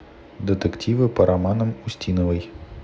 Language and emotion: Russian, neutral